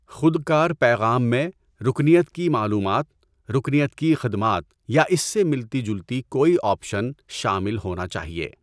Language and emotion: Urdu, neutral